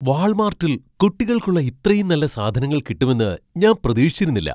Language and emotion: Malayalam, surprised